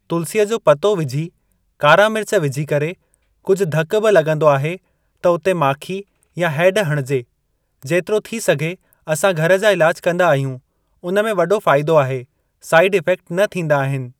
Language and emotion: Sindhi, neutral